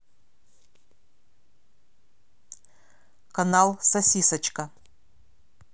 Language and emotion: Russian, neutral